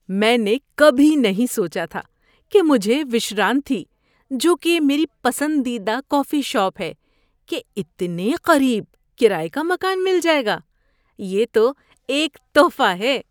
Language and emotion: Urdu, surprised